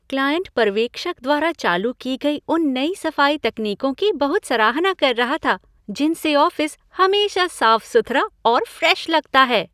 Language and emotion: Hindi, happy